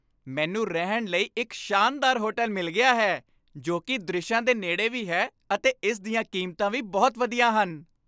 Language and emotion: Punjabi, happy